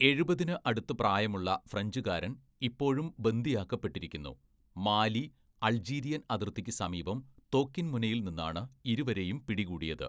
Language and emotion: Malayalam, neutral